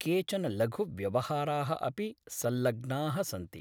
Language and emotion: Sanskrit, neutral